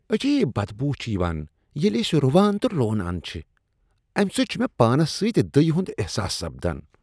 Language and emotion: Kashmiri, disgusted